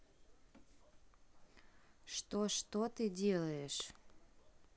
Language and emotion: Russian, neutral